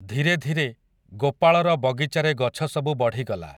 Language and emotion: Odia, neutral